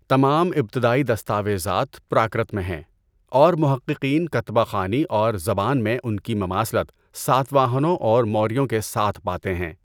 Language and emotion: Urdu, neutral